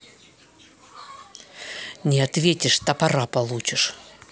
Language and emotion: Russian, angry